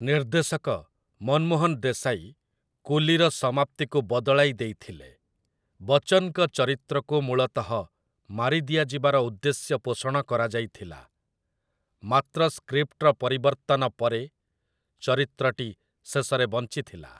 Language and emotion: Odia, neutral